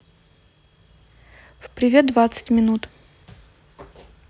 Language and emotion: Russian, neutral